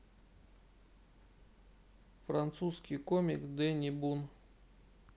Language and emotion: Russian, neutral